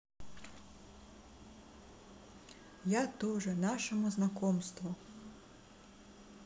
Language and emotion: Russian, neutral